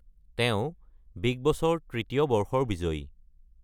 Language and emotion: Assamese, neutral